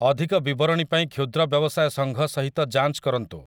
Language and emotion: Odia, neutral